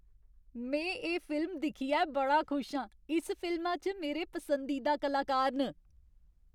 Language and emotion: Dogri, happy